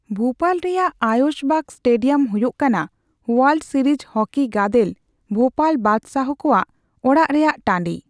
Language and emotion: Santali, neutral